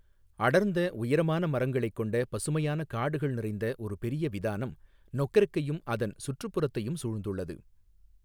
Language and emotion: Tamil, neutral